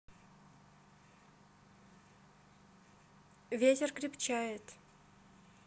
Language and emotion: Russian, neutral